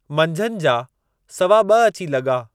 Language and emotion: Sindhi, neutral